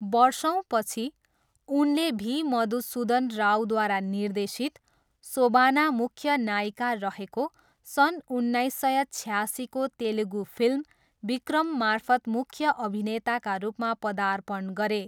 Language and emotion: Nepali, neutral